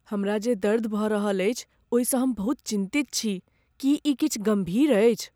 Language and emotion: Maithili, fearful